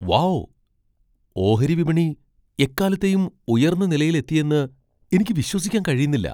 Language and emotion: Malayalam, surprised